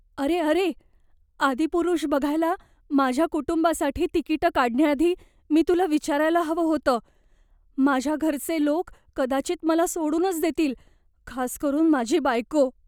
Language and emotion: Marathi, fearful